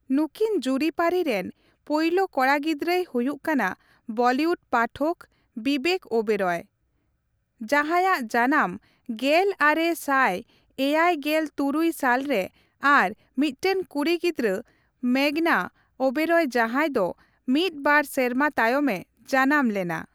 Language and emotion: Santali, neutral